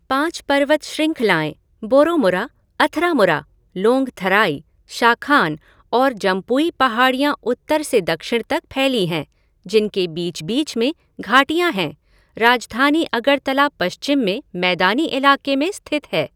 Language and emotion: Hindi, neutral